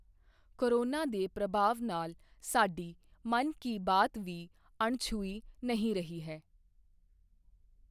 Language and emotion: Punjabi, neutral